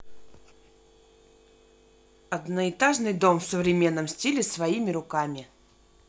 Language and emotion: Russian, neutral